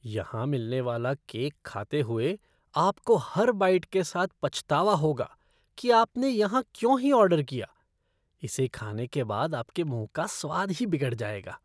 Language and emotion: Hindi, disgusted